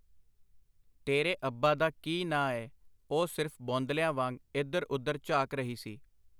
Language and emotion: Punjabi, neutral